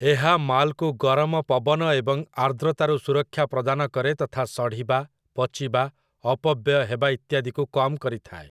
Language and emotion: Odia, neutral